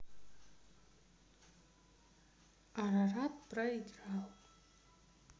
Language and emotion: Russian, sad